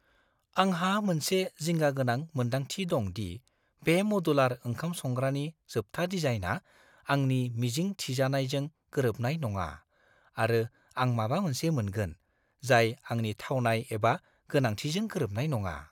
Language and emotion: Bodo, fearful